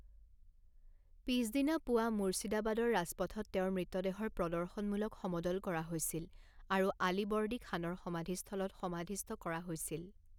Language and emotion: Assamese, neutral